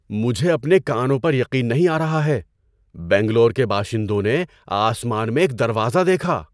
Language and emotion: Urdu, surprised